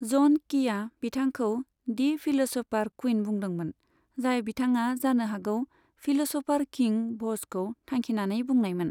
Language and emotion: Bodo, neutral